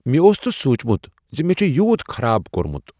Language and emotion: Kashmiri, surprised